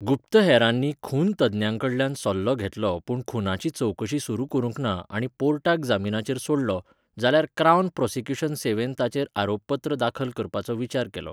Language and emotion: Goan Konkani, neutral